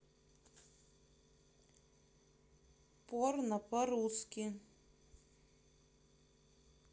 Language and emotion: Russian, neutral